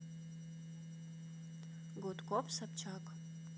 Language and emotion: Russian, neutral